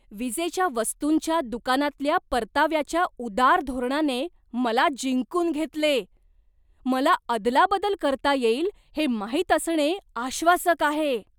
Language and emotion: Marathi, surprised